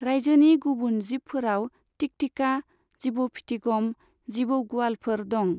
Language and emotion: Bodo, neutral